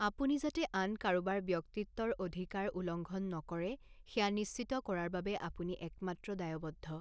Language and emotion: Assamese, neutral